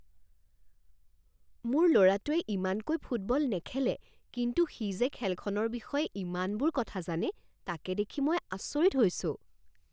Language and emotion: Assamese, surprised